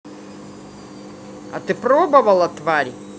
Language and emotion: Russian, angry